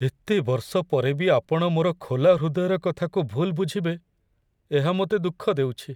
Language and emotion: Odia, sad